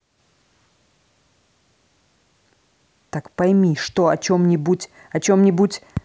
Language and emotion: Russian, angry